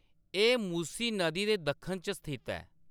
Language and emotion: Dogri, neutral